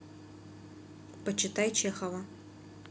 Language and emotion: Russian, neutral